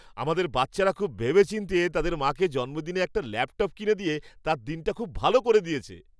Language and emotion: Bengali, happy